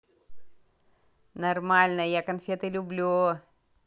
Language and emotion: Russian, positive